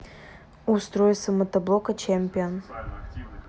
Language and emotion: Russian, neutral